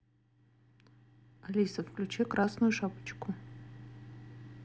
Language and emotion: Russian, neutral